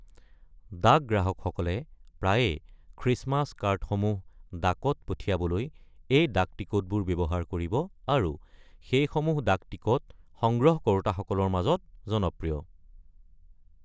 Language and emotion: Assamese, neutral